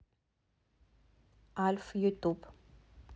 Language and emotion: Russian, neutral